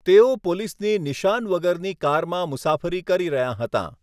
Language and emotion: Gujarati, neutral